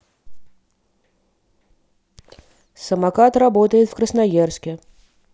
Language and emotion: Russian, neutral